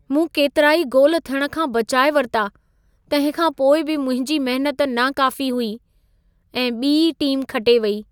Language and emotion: Sindhi, sad